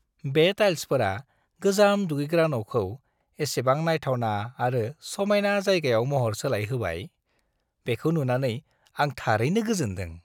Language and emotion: Bodo, happy